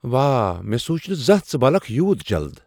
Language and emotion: Kashmiri, surprised